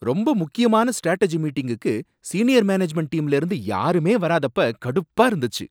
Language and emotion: Tamil, angry